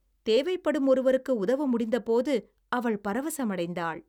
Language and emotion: Tamil, happy